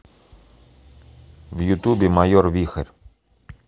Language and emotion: Russian, neutral